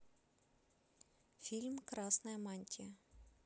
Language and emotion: Russian, neutral